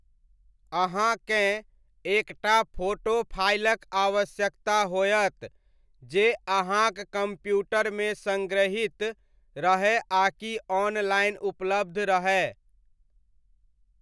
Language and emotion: Maithili, neutral